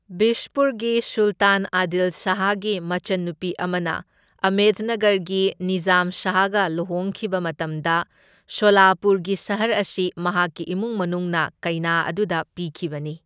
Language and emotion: Manipuri, neutral